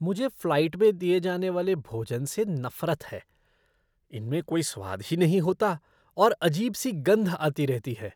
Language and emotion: Hindi, disgusted